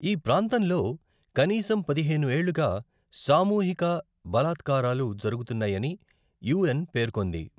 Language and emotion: Telugu, neutral